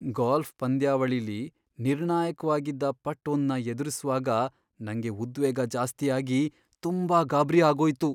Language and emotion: Kannada, fearful